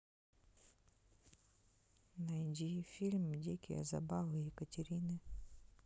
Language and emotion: Russian, neutral